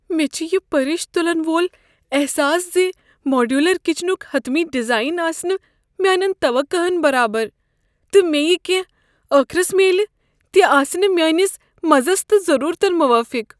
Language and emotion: Kashmiri, fearful